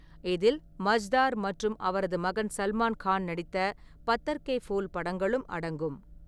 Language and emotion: Tamil, neutral